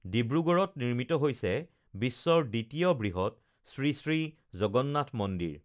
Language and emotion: Assamese, neutral